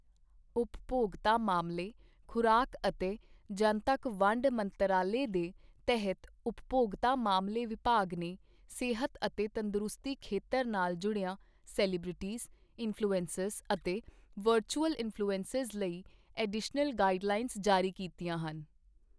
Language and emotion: Punjabi, neutral